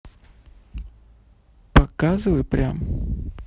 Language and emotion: Russian, neutral